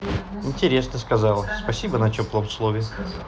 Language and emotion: Russian, neutral